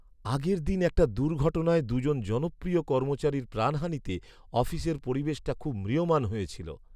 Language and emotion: Bengali, sad